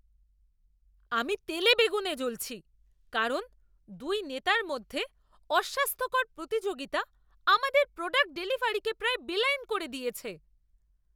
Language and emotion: Bengali, angry